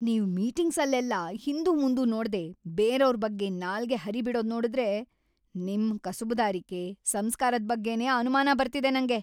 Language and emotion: Kannada, angry